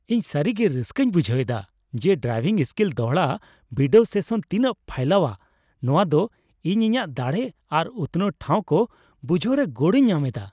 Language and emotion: Santali, happy